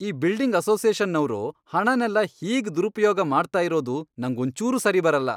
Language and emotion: Kannada, angry